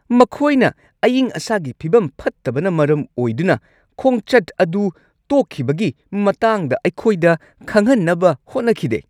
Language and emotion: Manipuri, angry